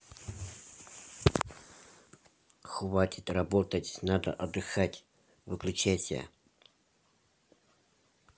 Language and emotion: Russian, angry